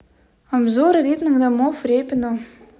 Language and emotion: Russian, neutral